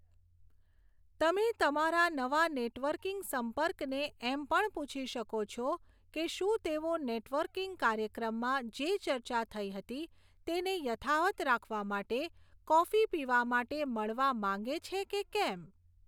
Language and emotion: Gujarati, neutral